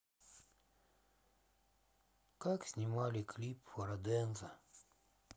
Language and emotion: Russian, sad